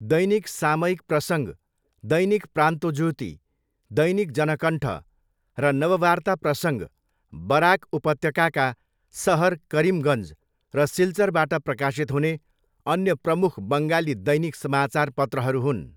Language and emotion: Nepali, neutral